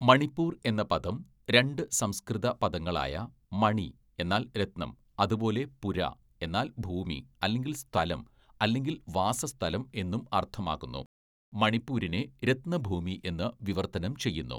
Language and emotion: Malayalam, neutral